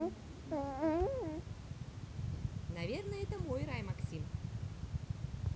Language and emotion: Russian, positive